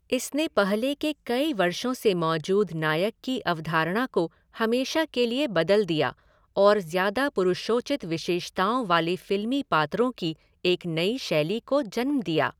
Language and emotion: Hindi, neutral